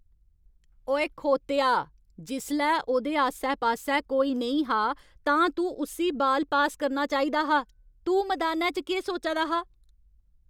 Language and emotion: Dogri, angry